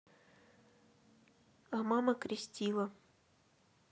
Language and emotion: Russian, neutral